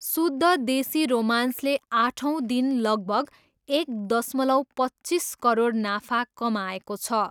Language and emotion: Nepali, neutral